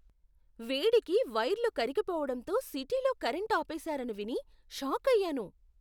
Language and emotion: Telugu, surprised